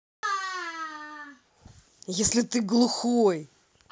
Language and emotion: Russian, angry